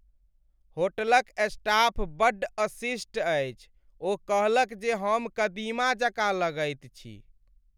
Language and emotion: Maithili, sad